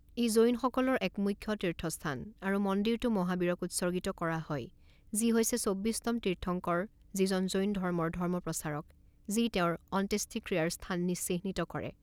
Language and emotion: Assamese, neutral